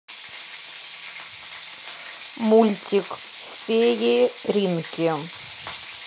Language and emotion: Russian, neutral